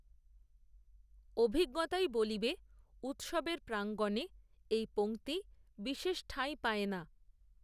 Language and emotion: Bengali, neutral